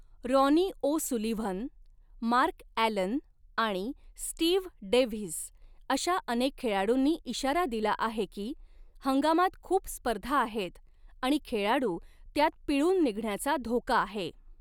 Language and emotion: Marathi, neutral